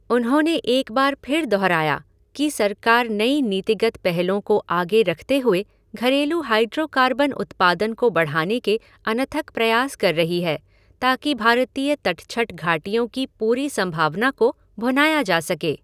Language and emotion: Hindi, neutral